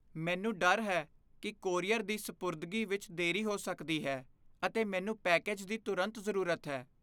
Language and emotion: Punjabi, fearful